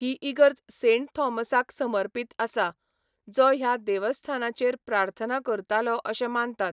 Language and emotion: Goan Konkani, neutral